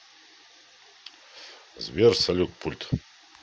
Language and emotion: Russian, neutral